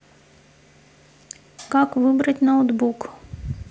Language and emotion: Russian, neutral